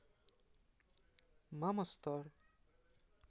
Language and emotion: Russian, neutral